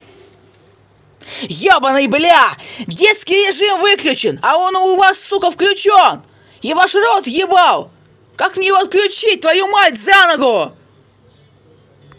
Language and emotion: Russian, angry